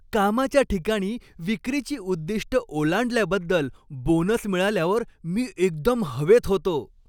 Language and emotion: Marathi, happy